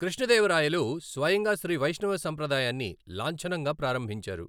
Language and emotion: Telugu, neutral